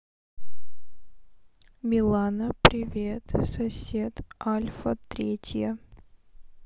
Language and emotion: Russian, sad